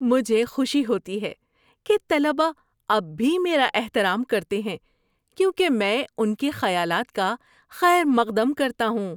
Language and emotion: Urdu, happy